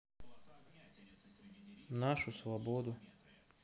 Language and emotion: Russian, neutral